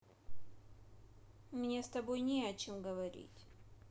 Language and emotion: Russian, sad